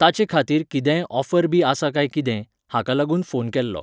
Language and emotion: Goan Konkani, neutral